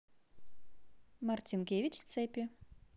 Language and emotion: Russian, positive